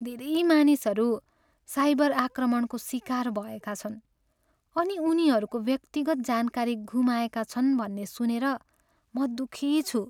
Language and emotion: Nepali, sad